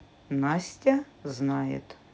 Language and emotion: Russian, neutral